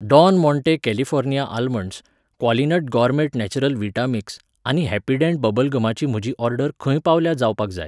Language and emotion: Goan Konkani, neutral